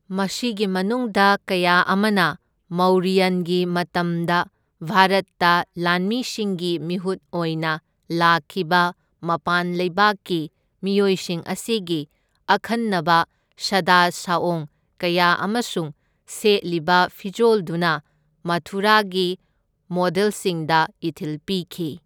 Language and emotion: Manipuri, neutral